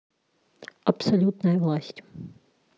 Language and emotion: Russian, neutral